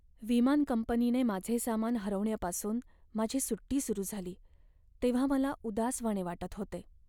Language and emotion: Marathi, sad